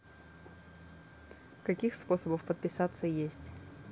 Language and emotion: Russian, neutral